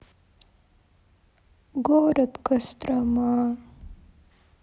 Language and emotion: Russian, sad